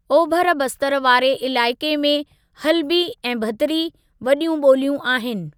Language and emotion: Sindhi, neutral